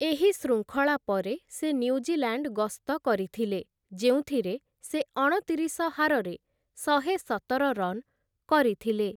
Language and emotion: Odia, neutral